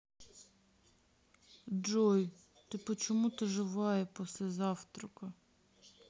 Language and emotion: Russian, sad